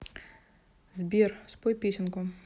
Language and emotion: Russian, neutral